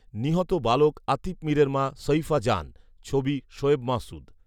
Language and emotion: Bengali, neutral